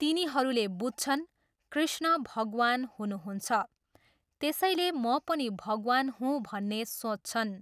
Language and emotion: Nepali, neutral